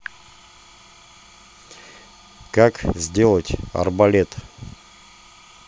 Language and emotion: Russian, neutral